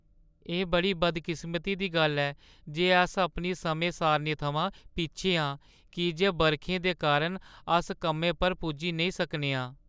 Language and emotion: Dogri, sad